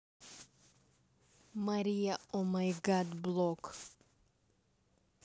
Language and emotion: Russian, neutral